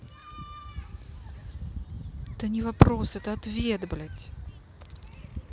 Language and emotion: Russian, angry